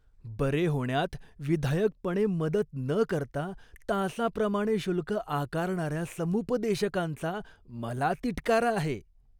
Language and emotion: Marathi, disgusted